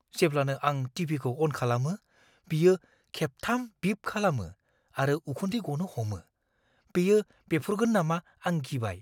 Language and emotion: Bodo, fearful